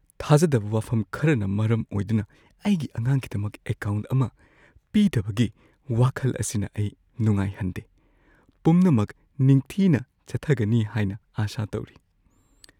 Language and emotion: Manipuri, fearful